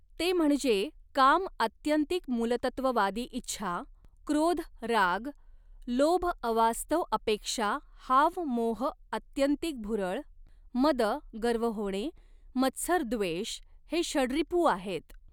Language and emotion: Marathi, neutral